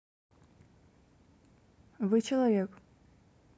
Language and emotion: Russian, neutral